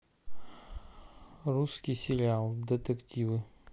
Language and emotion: Russian, neutral